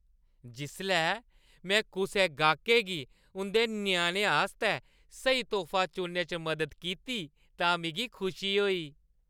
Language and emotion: Dogri, happy